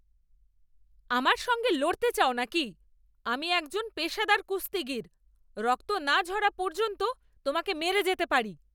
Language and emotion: Bengali, angry